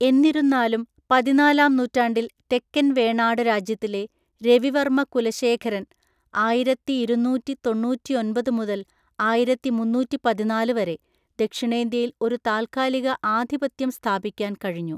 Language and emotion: Malayalam, neutral